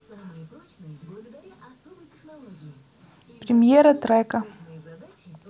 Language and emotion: Russian, neutral